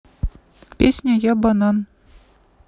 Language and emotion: Russian, neutral